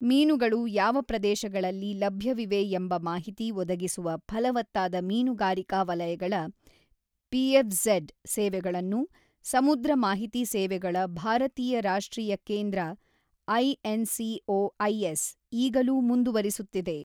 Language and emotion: Kannada, neutral